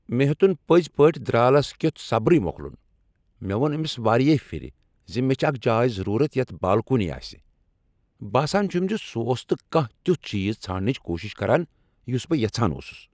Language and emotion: Kashmiri, angry